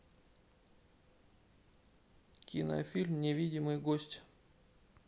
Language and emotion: Russian, neutral